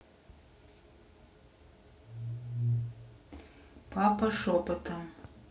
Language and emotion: Russian, neutral